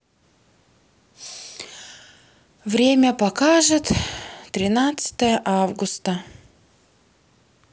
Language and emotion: Russian, sad